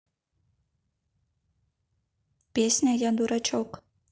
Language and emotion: Russian, neutral